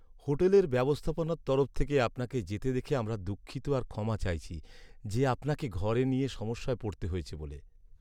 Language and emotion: Bengali, sad